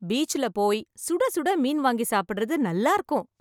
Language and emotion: Tamil, happy